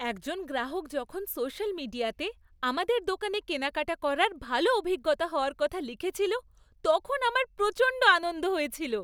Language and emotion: Bengali, happy